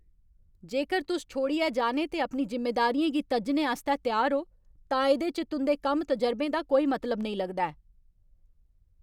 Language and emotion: Dogri, angry